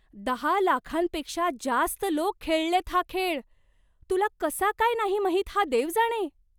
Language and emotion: Marathi, surprised